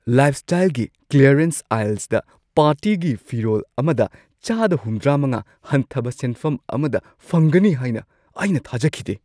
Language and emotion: Manipuri, surprised